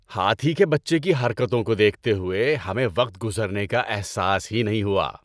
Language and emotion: Urdu, happy